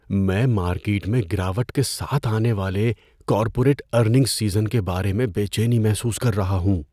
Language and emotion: Urdu, fearful